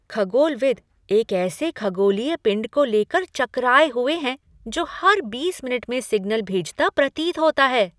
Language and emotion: Hindi, surprised